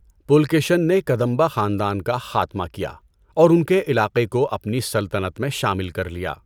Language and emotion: Urdu, neutral